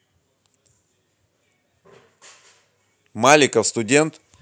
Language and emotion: Russian, neutral